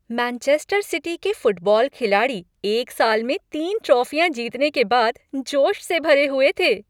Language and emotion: Hindi, happy